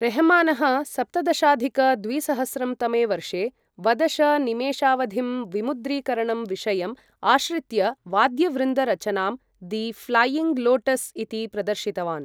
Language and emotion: Sanskrit, neutral